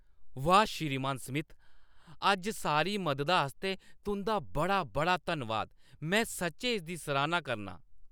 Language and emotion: Dogri, happy